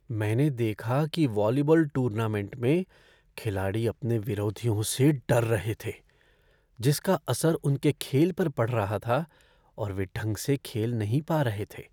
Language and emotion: Hindi, fearful